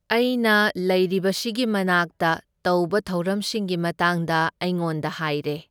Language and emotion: Manipuri, neutral